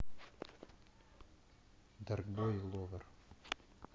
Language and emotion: Russian, neutral